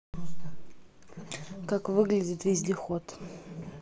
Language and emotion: Russian, neutral